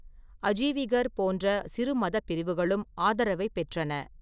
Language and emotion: Tamil, neutral